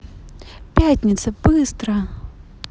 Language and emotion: Russian, neutral